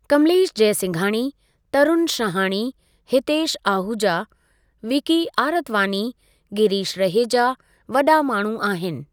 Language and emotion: Sindhi, neutral